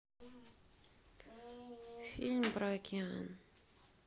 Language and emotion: Russian, sad